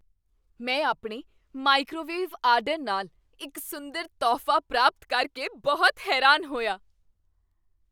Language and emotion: Punjabi, surprised